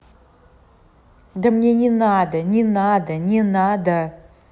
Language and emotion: Russian, angry